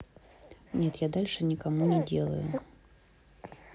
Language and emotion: Russian, neutral